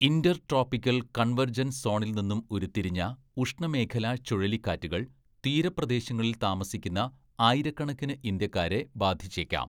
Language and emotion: Malayalam, neutral